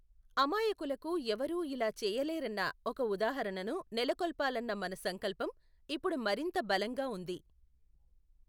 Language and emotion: Telugu, neutral